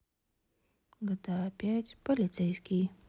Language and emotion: Russian, sad